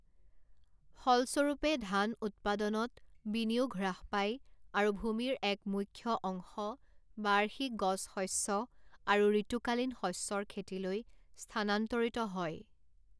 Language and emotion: Assamese, neutral